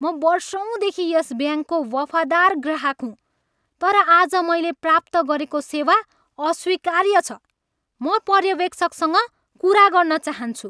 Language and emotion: Nepali, angry